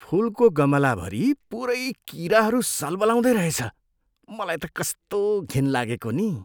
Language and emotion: Nepali, disgusted